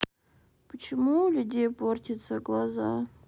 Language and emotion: Russian, sad